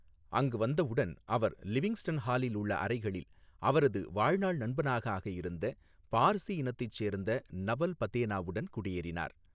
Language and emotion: Tamil, neutral